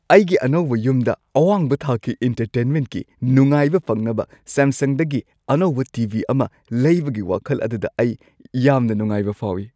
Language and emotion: Manipuri, happy